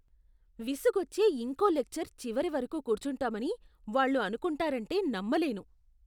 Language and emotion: Telugu, disgusted